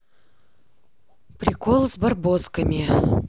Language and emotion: Russian, neutral